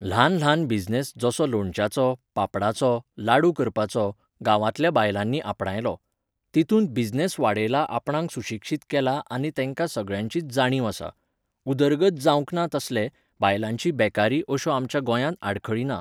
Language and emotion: Goan Konkani, neutral